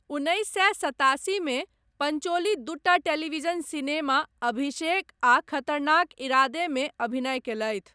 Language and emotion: Maithili, neutral